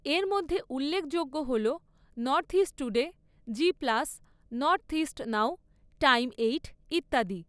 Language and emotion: Bengali, neutral